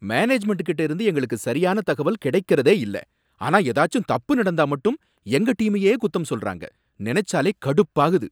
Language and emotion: Tamil, angry